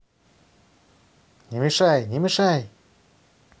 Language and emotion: Russian, angry